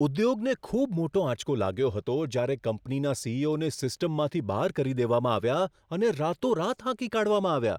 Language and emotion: Gujarati, surprised